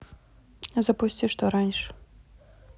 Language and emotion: Russian, neutral